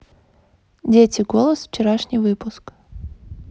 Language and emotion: Russian, neutral